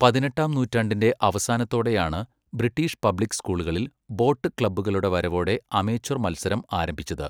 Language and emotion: Malayalam, neutral